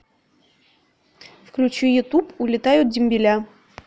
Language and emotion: Russian, neutral